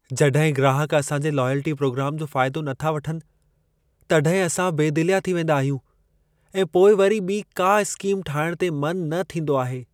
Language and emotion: Sindhi, sad